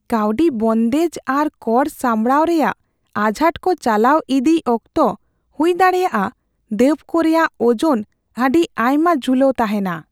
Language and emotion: Santali, fearful